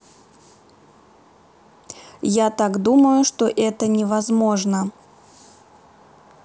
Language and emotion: Russian, neutral